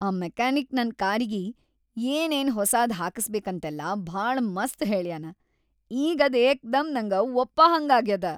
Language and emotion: Kannada, happy